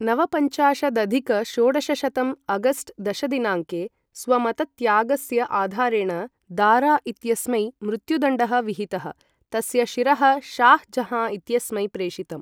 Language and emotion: Sanskrit, neutral